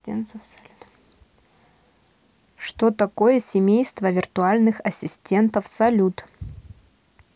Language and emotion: Russian, neutral